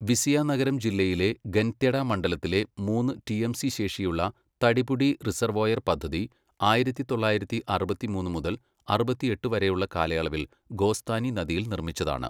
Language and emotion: Malayalam, neutral